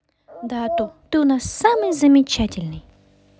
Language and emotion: Russian, positive